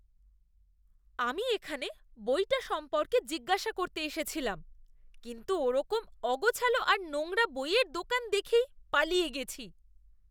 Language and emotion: Bengali, disgusted